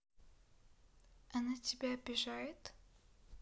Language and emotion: Russian, neutral